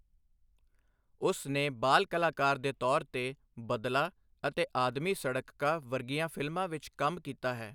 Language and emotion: Punjabi, neutral